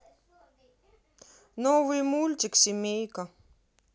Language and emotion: Russian, neutral